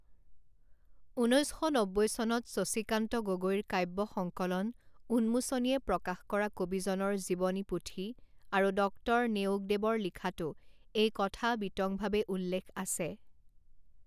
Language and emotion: Assamese, neutral